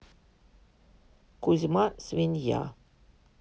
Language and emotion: Russian, neutral